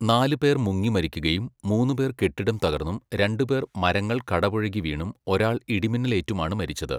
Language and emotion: Malayalam, neutral